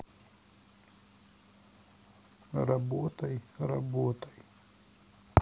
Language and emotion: Russian, sad